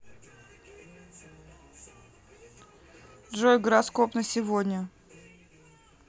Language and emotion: Russian, neutral